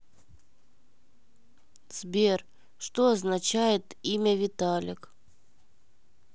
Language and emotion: Russian, sad